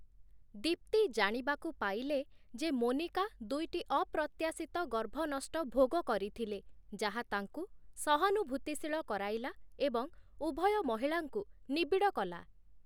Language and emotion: Odia, neutral